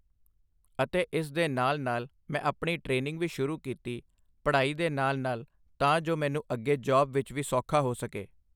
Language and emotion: Punjabi, neutral